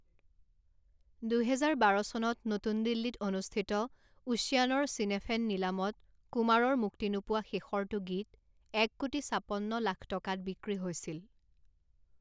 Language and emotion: Assamese, neutral